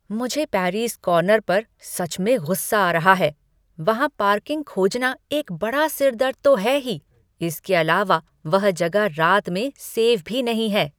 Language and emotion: Hindi, angry